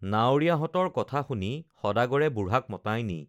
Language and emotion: Assamese, neutral